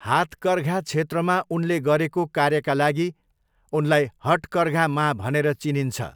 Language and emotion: Nepali, neutral